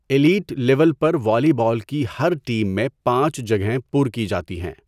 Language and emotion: Urdu, neutral